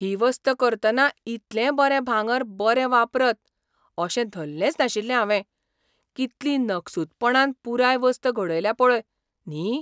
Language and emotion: Goan Konkani, surprised